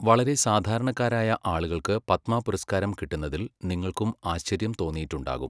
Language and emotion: Malayalam, neutral